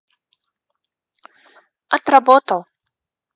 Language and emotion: Russian, neutral